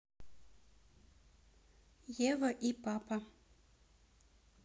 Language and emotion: Russian, neutral